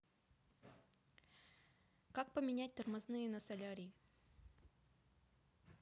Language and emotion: Russian, neutral